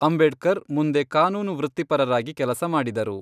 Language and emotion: Kannada, neutral